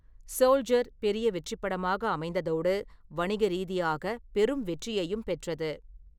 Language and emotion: Tamil, neutral